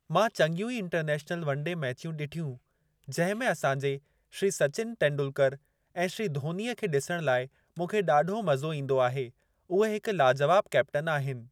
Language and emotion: Sindhi, neutral